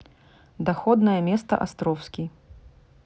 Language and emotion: Russian, neutral